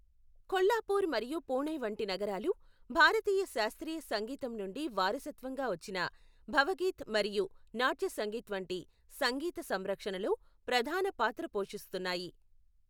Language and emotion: Telugu, neutral